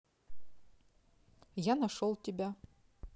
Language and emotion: Russian, neutral